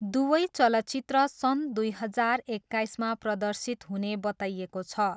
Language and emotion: Nepali, neutral